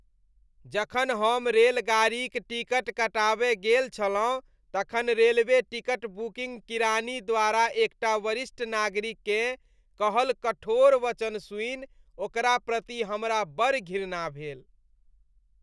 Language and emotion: Maithili, disgusted